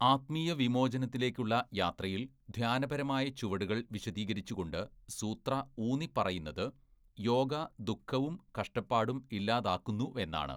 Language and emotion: Malayalam, neutral